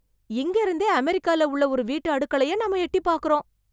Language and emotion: Tamil, surprised